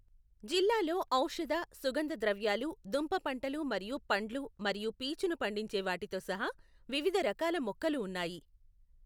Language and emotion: Telugu, neutral